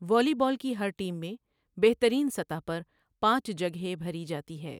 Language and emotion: Urdu, neutral